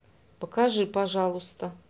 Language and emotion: Russian, neutral